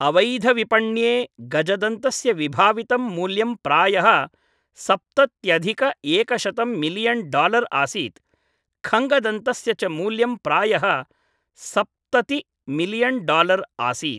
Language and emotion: Sanskrit, neutral